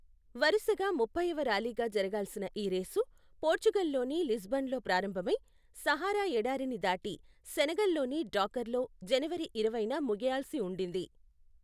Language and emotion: Telugu, neutral